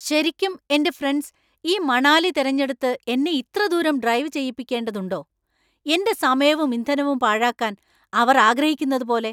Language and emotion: Malayalam, angry